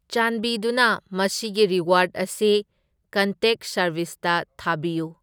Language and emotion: Manipuri, neutral